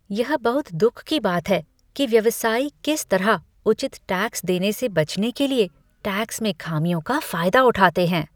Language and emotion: Hindi, disgusted